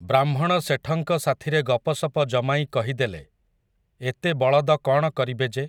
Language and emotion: Odia, neutral